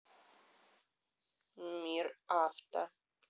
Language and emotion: Russian, neutral